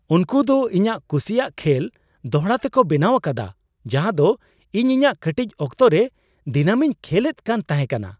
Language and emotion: Santali, surprised